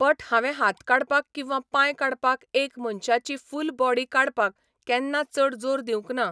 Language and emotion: Goan Konkani, neutral